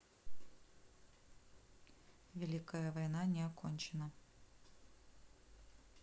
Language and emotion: Russian, neutral